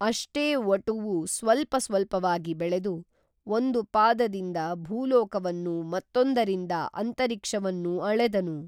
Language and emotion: Kannada, neutral